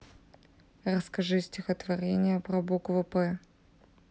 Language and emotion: Russian, neutral